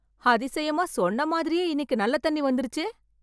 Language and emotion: Tamil, surprised